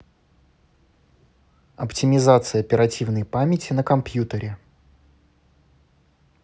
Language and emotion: Russian, neutral